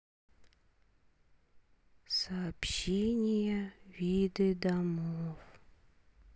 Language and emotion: Russian, sad